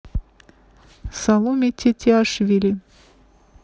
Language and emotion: Russian, neutral